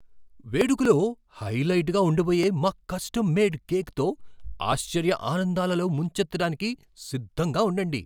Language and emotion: Telugu, surprised